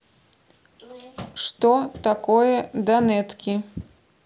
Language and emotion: Russian, neutral